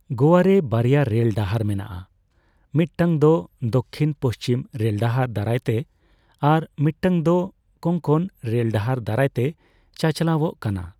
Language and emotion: Santali, neutral